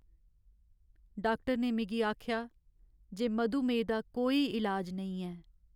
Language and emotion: Dogri, sad